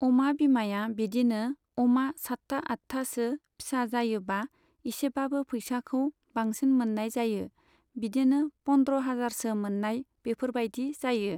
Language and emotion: Bodo, neutral